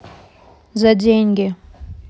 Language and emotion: Russian, neutral